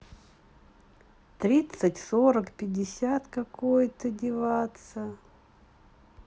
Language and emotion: Russian, neutral